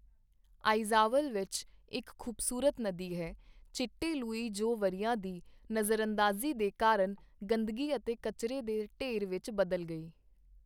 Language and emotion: Punjabi, neutral